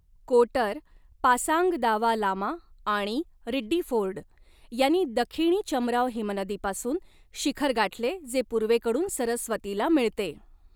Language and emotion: Marathi, neutral